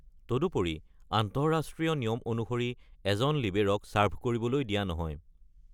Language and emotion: Assamese, neutral